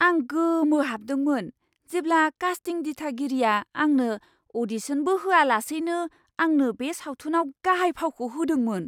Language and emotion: Bodo, surprised